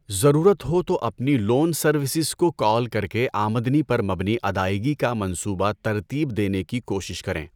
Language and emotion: Urdu, neutral